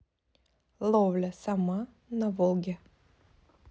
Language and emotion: Russian, neutral